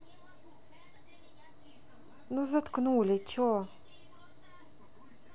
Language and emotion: Russian, neutral